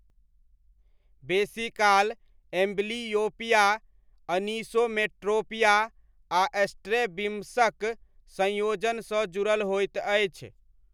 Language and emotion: Maithili, neutral